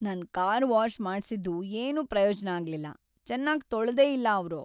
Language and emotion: Kannada, sad